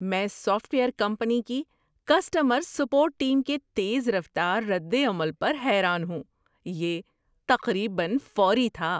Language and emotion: Urdu, surprised